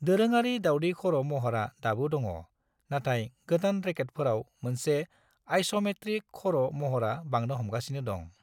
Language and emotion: Bodo, neutral